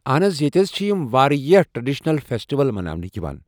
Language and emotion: Kashmiri, neutral